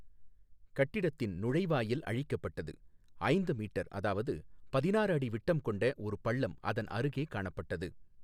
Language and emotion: Tamil, neutral